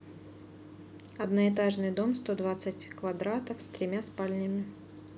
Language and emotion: Russian, neutral